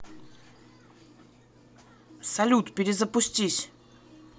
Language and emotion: Russian, neutral